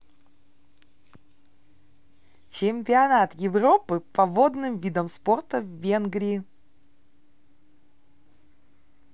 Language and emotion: Russian, positive